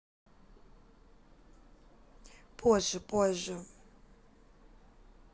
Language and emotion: Russian, neutral